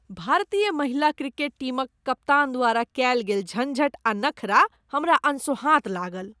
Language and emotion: Maithili, disgusted